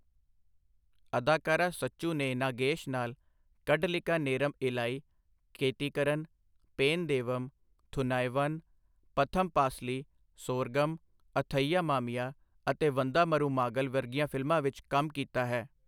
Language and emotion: Punjabi, neutral